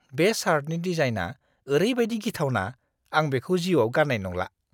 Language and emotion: Bodo, disgusted